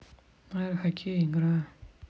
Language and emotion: Russian, neutral